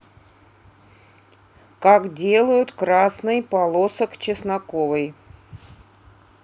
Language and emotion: Russian, neutral